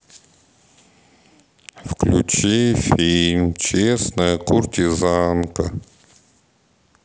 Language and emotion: Russian, sad